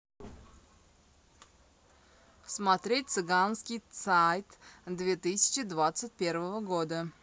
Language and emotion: Russian, positive